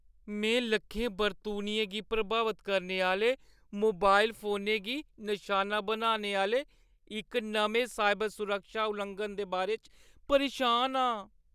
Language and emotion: Dogri, fearful